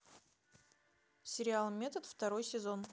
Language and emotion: Russian, neutral